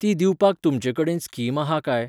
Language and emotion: Goan Konkani, neutral